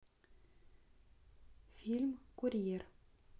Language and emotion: Russian, neutral